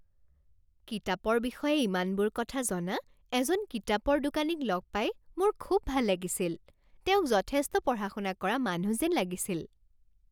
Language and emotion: Assamese, happy